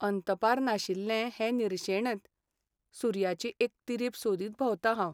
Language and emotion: Goan Konkani, sad